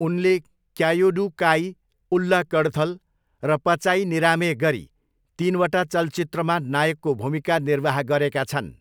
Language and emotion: Nepali, neutral